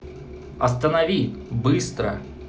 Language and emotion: Russian, angry